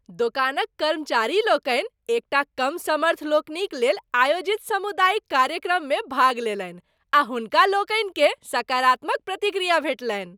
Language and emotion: Maithili, happy